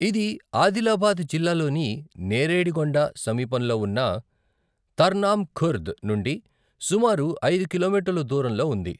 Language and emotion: Telugu, neutral